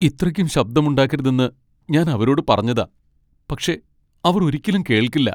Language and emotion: Malayalam, sad